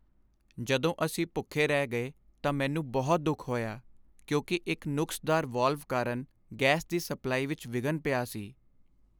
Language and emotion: Punjabi, sad